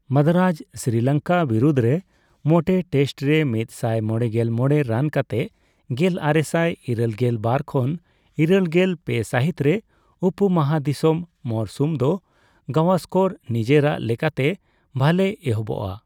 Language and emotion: Santali, neutral